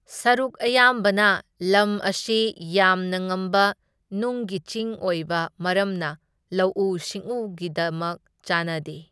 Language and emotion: Manipuri, neutral